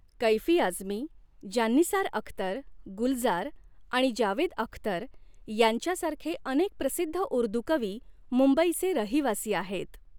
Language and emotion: Marathi, neutral